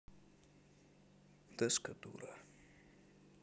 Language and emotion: Russian, sad